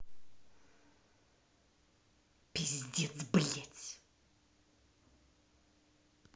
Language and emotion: Russian, angry